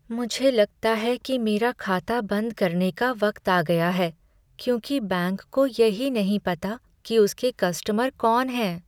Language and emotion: Hindi, sad